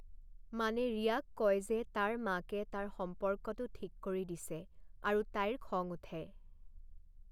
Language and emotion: Assamese, neutral